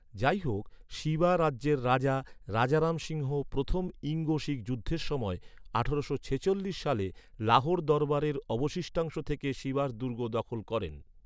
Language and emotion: Bengali, neutral